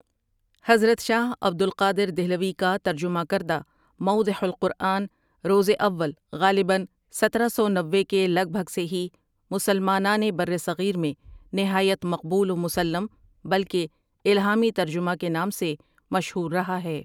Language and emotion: Urdu, neutral